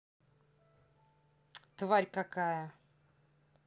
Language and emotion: Russian, angry